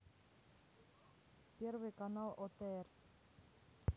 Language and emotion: Russian, neutral